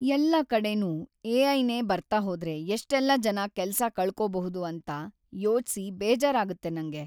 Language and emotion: Kannada, sad